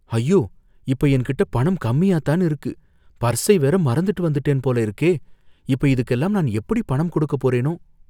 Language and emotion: Tamil, fearful